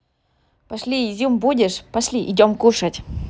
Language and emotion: Russian, positive